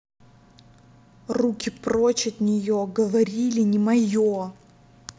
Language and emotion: Russian, angry